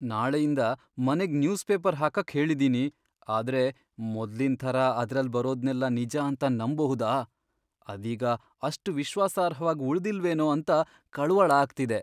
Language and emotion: Kannada, fearful